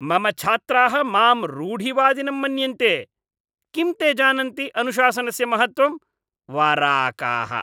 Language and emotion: Sanskrit, disgusted